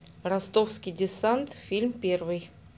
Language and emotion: Russian, neutral